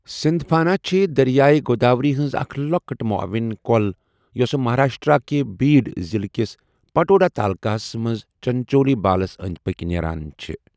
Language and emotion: Kashmiri, neutral